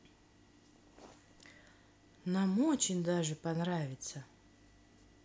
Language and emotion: Russian, positive